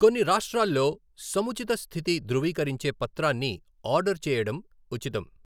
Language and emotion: Telugu, neutral